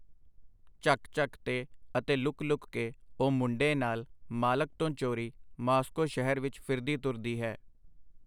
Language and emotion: Punjabi, neutral